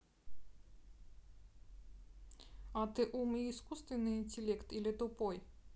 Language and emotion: Russian, neutral